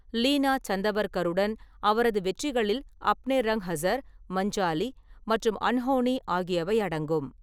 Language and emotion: Tamil, neutral